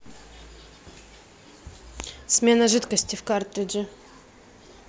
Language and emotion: Russian, neutral